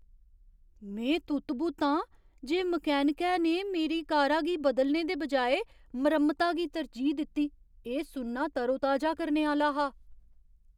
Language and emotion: Dogri, surprised